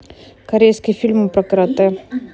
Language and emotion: Russian, neutral